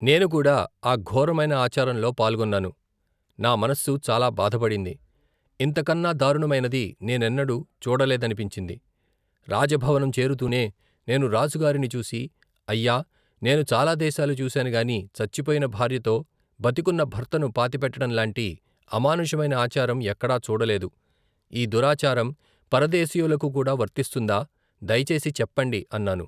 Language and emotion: Telugu, neutral